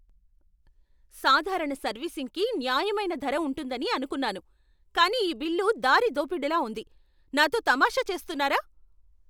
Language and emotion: Telugu, angry